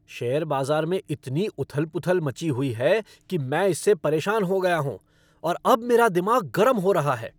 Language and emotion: Hindi, angry